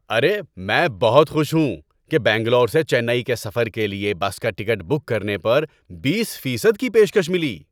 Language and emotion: Urdu, happy